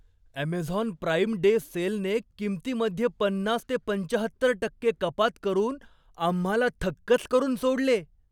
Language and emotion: Marathi, surprised